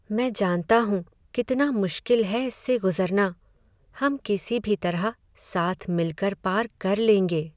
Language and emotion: Hindi, sad